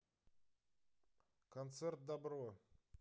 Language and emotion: Russian, neutral